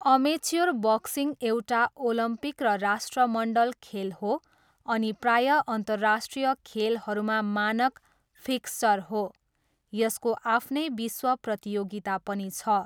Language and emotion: Nepali, neutral